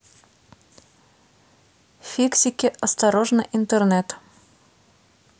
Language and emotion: Russian, neutral